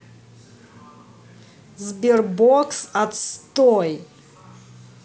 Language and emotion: Russian, angry